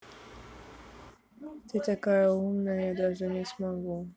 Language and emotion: Russian, neutral